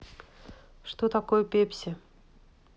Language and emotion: Russian, neutral